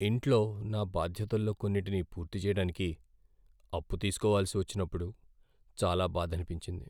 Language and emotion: Telugu, sad